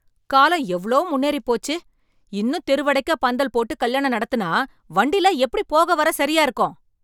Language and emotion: Tamil, angry